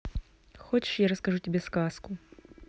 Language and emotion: Russian, neutral